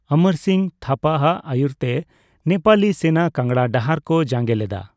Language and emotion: Santali, neutral